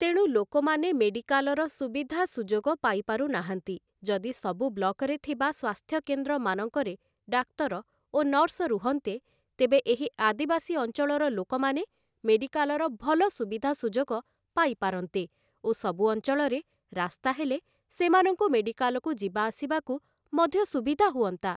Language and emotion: Odia, neutral